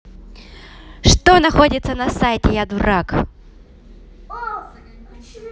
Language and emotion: Russian, positive